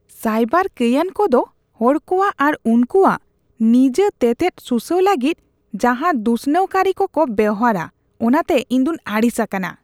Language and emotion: Santali, disgusted